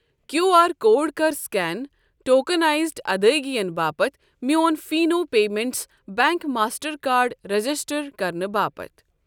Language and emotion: Kashmiri, neutral